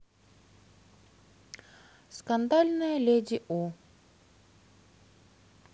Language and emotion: Russian, neutral